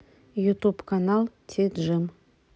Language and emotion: Russian, neutral